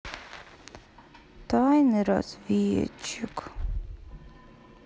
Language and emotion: Russian, sad